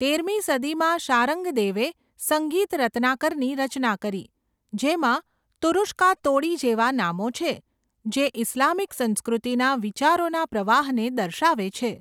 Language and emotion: Gujarati, neutral